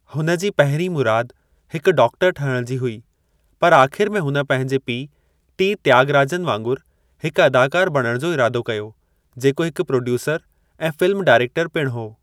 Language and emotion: Sindhi, neutral